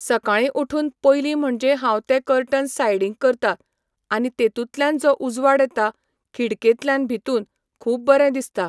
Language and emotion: Goan Konkani, neutral